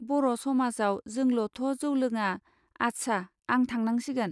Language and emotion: Bodo, neutral